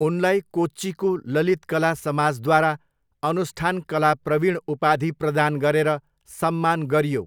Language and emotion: Nepali, neutral